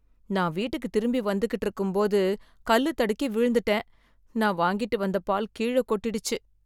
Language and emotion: Tamil, sad